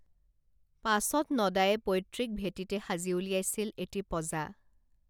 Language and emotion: Assamese, neutral